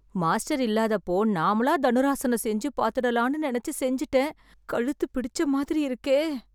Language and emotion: Tamil, fearful